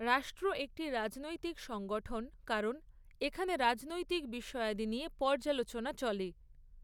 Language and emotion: Bengali, neutral